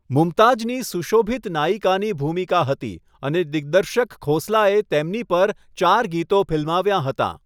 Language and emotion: Gujarati, neutral